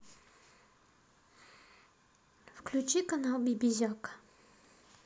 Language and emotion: Russian, neutral